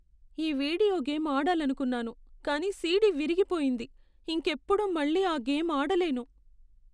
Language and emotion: Telugu, sad